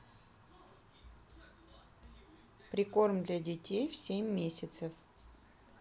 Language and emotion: Russian, neutral